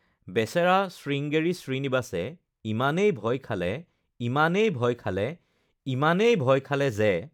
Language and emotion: Assamese, neutral